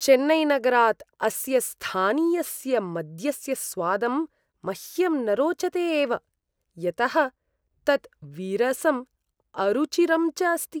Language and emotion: Sanskrit, disgusted